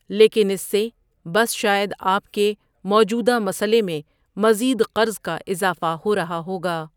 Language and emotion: Urdu, neutral